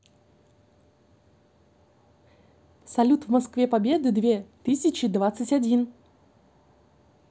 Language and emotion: Russian, positive